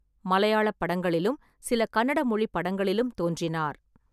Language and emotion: Tamil, neutral